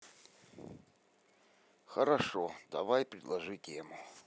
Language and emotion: Russian, neutral